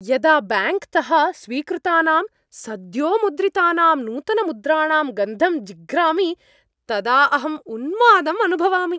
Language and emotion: Sanskrit, happy